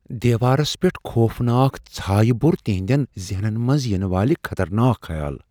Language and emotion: Kashmiri, fearful